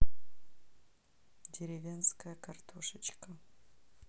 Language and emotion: Russian, neutral